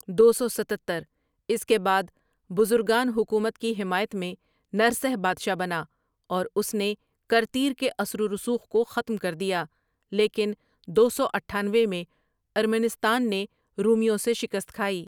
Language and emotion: Urdu, neutral